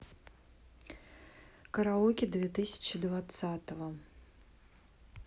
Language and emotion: Russian, neutral